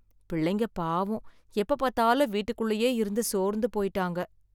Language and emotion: Tamil, sad